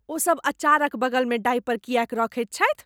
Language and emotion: Maithili, disgusted